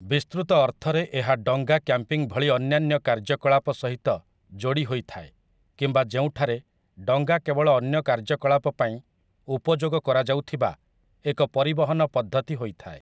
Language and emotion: Odia, neutral